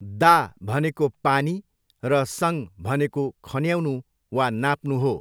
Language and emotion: Nepali, neutral